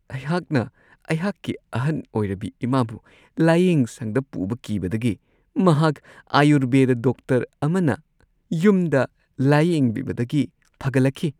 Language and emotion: Manipuri, happy